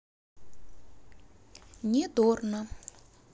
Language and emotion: Russian, neutral